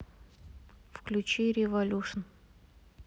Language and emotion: Russian, neutral